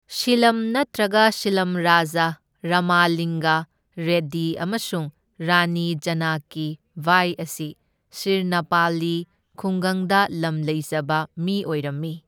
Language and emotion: Manipuri, neutral